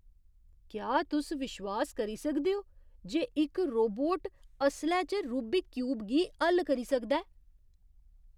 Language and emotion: Dogri, surprised